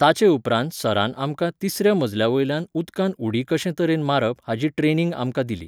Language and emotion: Goan Konkani, neutral